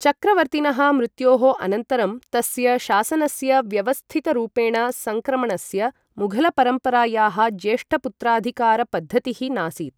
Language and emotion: Sanskrit, neutral